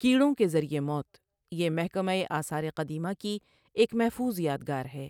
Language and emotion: Urdu, neutral